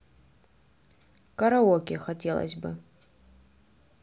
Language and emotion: Russian, neutral